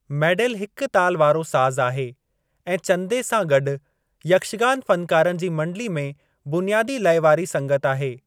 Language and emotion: Sindhi, neutral